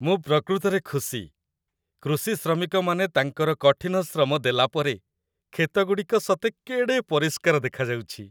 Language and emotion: Odia, happy